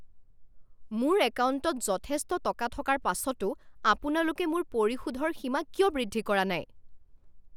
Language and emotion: Assamese, angry